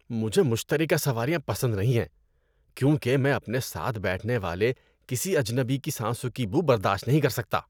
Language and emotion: Urdu, disgusted